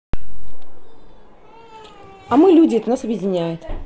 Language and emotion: Russian, neutral